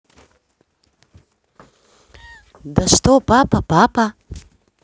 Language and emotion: Russian, neutral